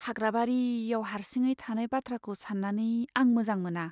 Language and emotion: Bodo, fearful